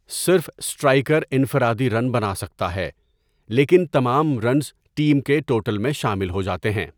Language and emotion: Urdu, neutral